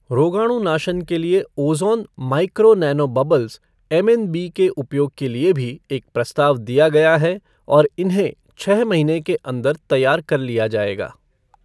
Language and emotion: Hindi, neutral